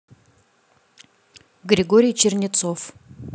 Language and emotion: Russian, neutral